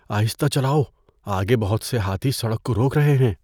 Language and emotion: Urdu, fearful